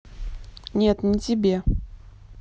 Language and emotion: Russian, neutral